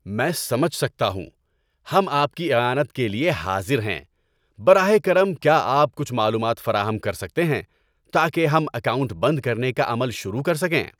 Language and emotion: Urdu, happy